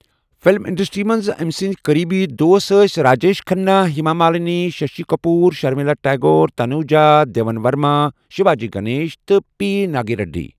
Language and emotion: Kashmiri, neutral